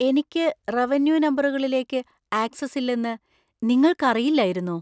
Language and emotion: Malayalam, surprised